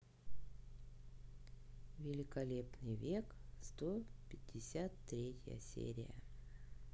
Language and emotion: Russian, neutral